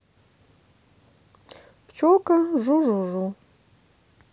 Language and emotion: Russian, neutral